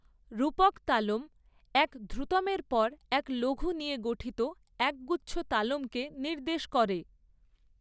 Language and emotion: Bengali, neutral